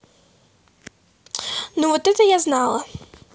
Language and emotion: Russian, neutral